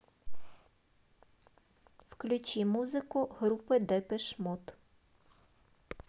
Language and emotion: Russian, neutral